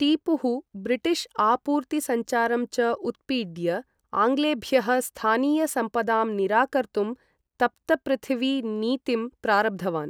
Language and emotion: Sanskrit, neutral